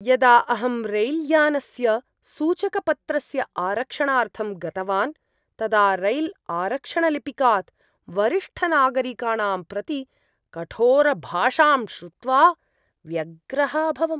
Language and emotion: Sanskrit, disgusted